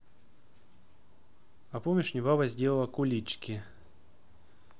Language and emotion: Russian, neutral